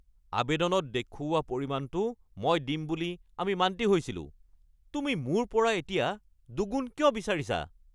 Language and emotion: Assamese, angry